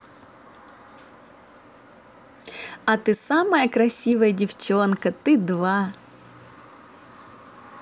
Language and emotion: Russian, positive